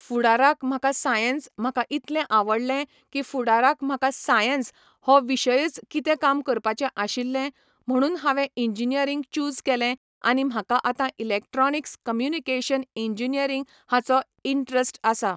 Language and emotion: Goan Konkani, neutral